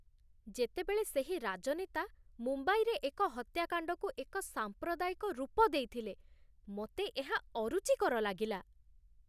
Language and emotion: Odia, disgusted